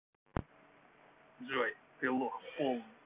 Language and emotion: Russian, angry